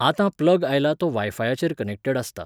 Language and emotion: Goan Konkani, neutral